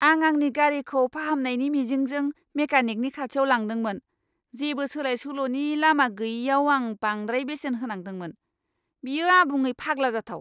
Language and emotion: Bodo, angry